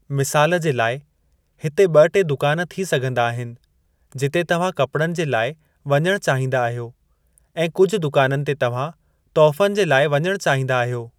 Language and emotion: Sindhi, neutral